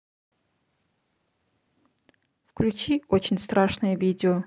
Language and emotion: Russian, neutral